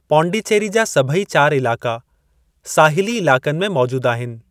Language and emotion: Sindhi, neutral